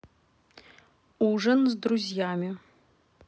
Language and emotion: Russian, neutral